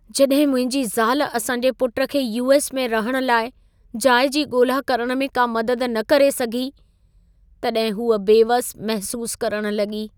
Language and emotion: Sindhi, sad